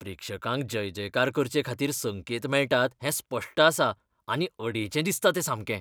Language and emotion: Goan Konkani, disgusted